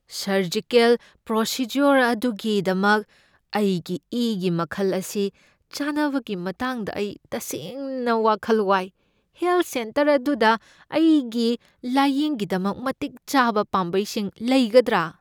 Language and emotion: Manipuri, fearful